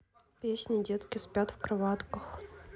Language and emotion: Russian, neutral